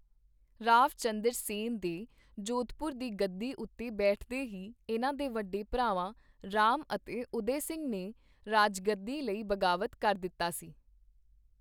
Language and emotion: Punjabi, neutral